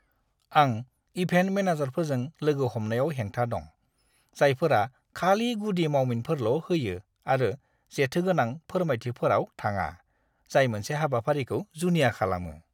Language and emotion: Bodo, disgusted